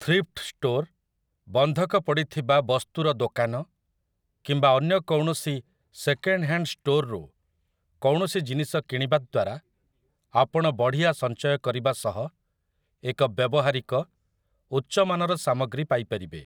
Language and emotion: Odia, neutral